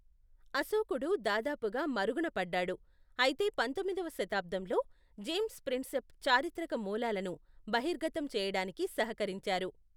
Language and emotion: Telugu, neutral